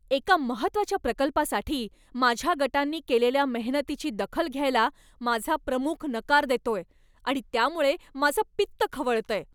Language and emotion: Marathi, angry